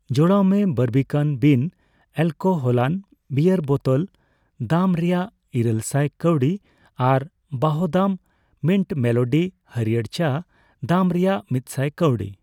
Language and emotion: Santali, neutral